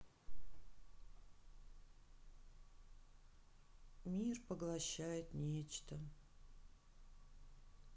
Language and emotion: Russian, sad